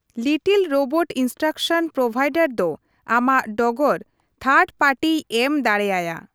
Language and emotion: Santali, neutral